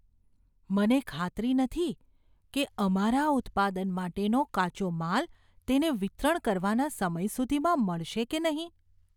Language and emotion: Gujarati, fearful